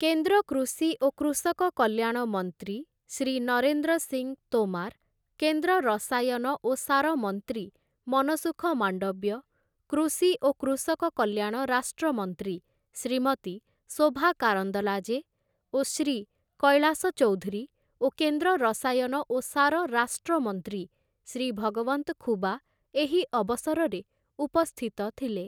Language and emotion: Odia, neutral